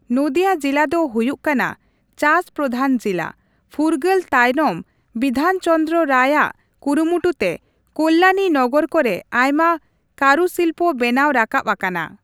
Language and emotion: Santali, neutral